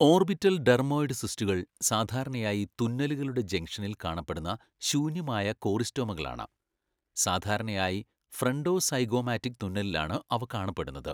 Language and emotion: Malayalam, neutral